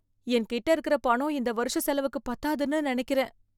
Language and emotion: Tamil, fearful